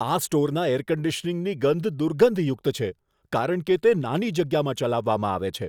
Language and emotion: Gujarati, disgusted